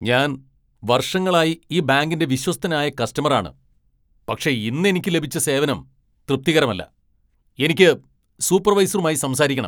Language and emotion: Malayalam, angry